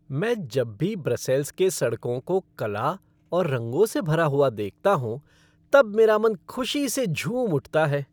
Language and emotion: Hindi, happy